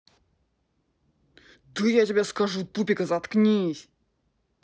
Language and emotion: Russian, angry